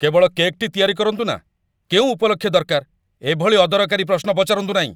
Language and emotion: Odia, angry